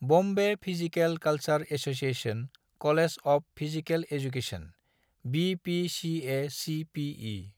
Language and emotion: Bodo, neutral